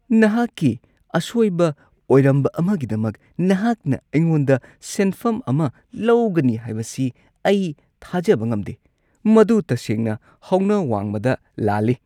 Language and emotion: Manipuri, disgusted